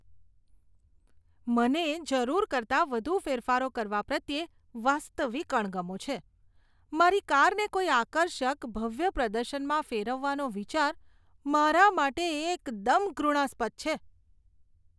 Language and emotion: Gujarati, disgusted